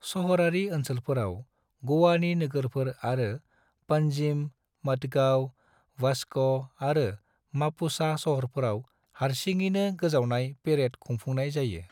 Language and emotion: Bodo, neutral